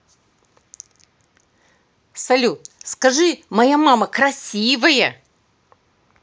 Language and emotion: Russian, positive